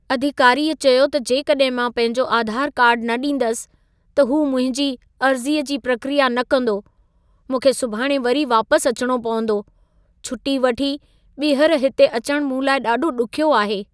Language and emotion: Sindhi, sad